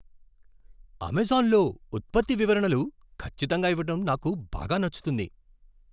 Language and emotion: Telugu, surprised